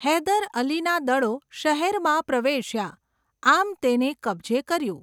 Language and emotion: Gujarati, neutral